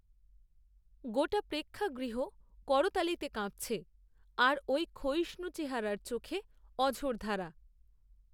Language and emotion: Bengali, neutral